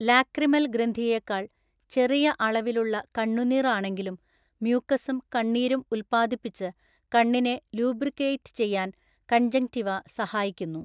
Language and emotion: Malayalam, neutral